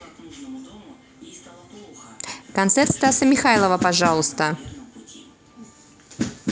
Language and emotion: Russian, neutral